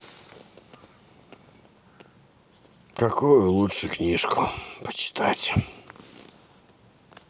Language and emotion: Russian, sad